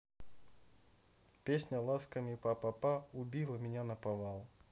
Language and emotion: Russian, neutral